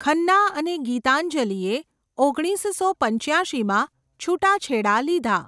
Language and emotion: Gujarati, neutral